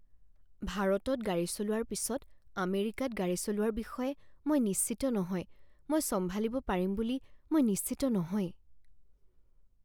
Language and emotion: Assamese, fearful